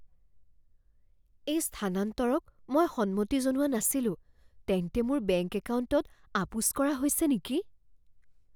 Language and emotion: Assamese, fearful